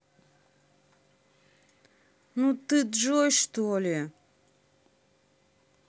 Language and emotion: Russian, angry